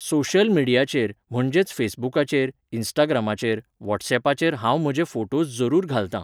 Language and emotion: Goan Konkani, neutral